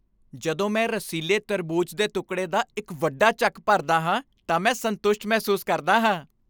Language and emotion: Punjabi, happy